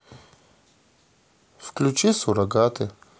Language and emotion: Russian, sad